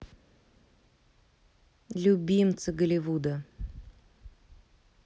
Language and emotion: Russian, neutral